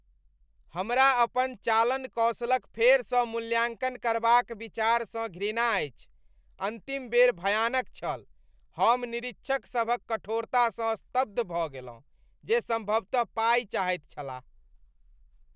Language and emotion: Maithili, disgusted